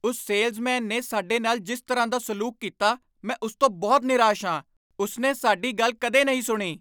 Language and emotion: Punjabi, angry